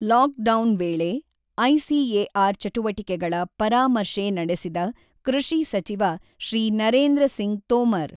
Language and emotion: Kannada, neutral